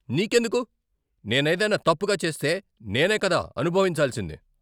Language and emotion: Telugu, angry